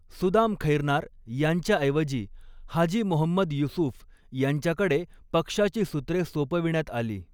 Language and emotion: Marathi, neutral